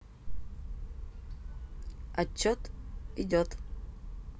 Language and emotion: Russian, neutral